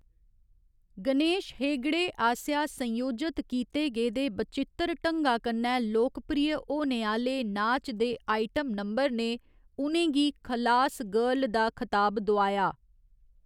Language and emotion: Dogri, neutral